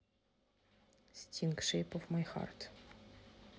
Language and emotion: Russian, neutral